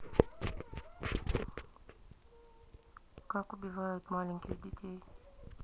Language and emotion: Russian, neutral